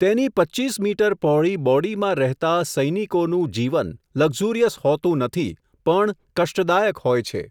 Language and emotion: Gujarati, neutral